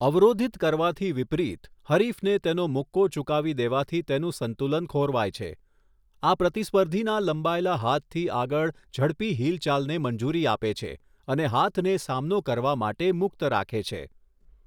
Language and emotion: Gujarati, neutral